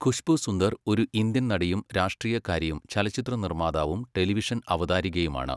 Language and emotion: Malayalam, neutral